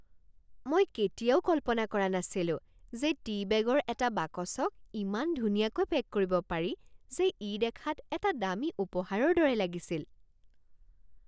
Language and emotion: Assamese, surprised